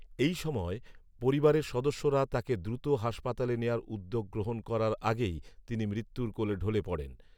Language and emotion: Bengali, neutral